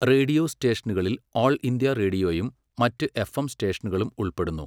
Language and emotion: Malayalam, neutral